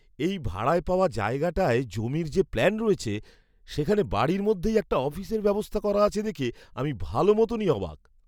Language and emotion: Bengali, surprised